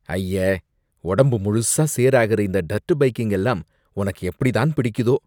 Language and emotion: Tamil, disgusted